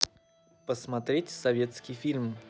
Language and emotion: Russian, neutral